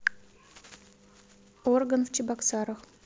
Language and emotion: Russian, neutral